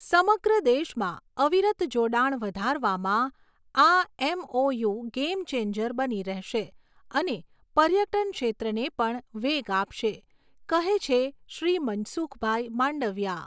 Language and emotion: Gujarati, neutral